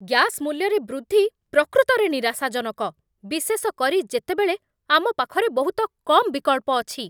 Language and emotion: Odia, angry